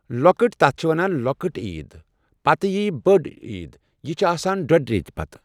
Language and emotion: Kashmiri, neutral